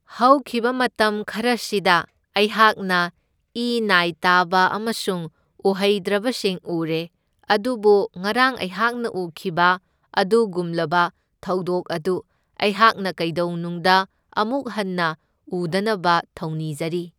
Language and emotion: Manipuri, neutral